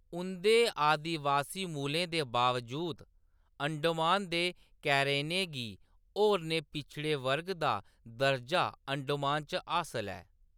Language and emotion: Dogri, neutral